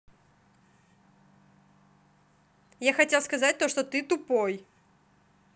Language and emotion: Russian, neutral